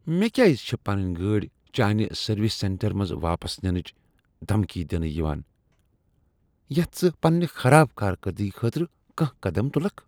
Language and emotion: Kashmiri, disgusted